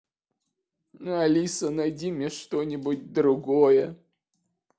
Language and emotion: Russian, sad